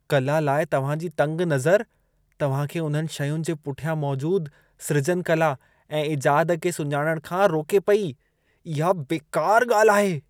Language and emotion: Sindhi, disgusted